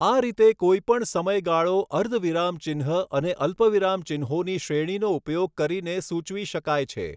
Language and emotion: Gujarati, neutral